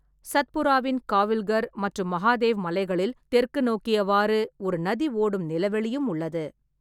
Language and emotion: Tamil, neutral